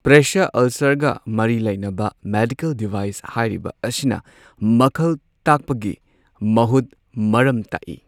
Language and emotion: Manipuri, neutral